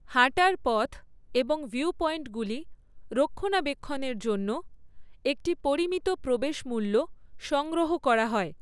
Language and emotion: Bengali, neutral